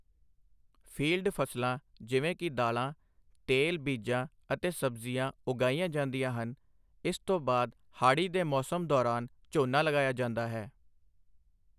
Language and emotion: Punjabi, neutral